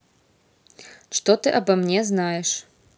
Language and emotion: Russian, neutral